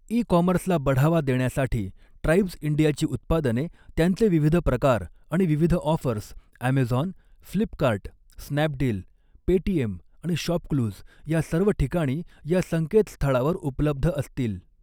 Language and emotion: Marathi, neutral